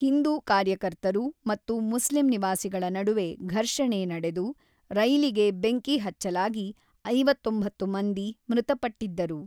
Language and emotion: Kannada, neutral